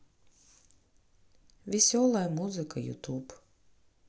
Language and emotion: Russian, sad